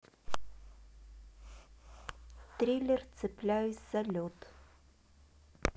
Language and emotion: Russian, neutral